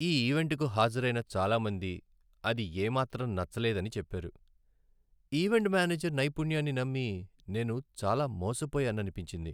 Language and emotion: Telugu, sad